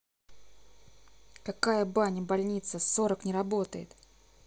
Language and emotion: Russian, angry